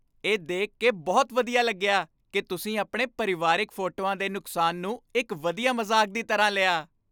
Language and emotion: Punjabi, happy